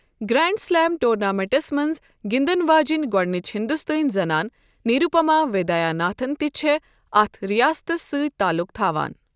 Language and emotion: Kashmiri, neutral